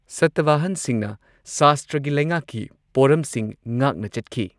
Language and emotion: Manipuri, neutral